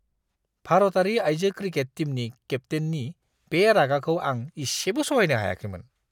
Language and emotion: Bodo, disgusted